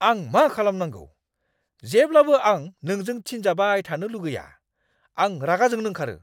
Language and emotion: Bodo, angry